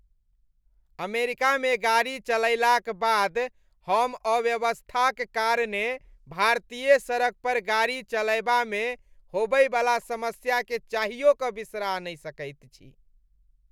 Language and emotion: Maithili, disgusted